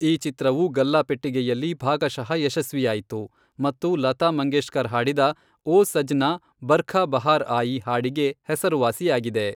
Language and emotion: Kannada, neutral